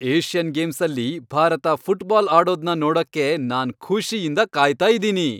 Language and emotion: Kannada, happy